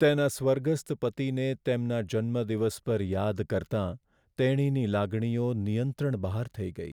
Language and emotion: Gujarati, sad